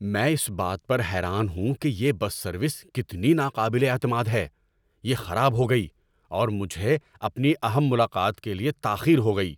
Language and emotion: Urdu, angry